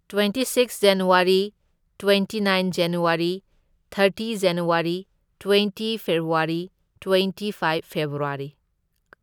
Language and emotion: Manipuri, neutral